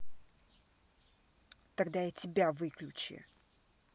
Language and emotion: Russian, angry